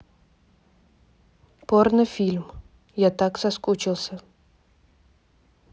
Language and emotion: Russian, neutral